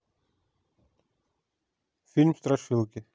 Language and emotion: Russian, neutral